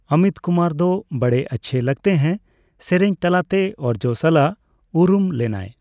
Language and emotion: Santali, neutral